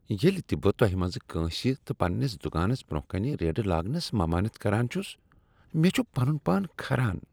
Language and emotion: Kashmiri, disgusted